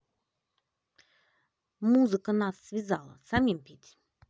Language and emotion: Russian, angry